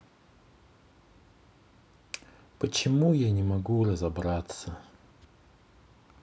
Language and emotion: Russian, sad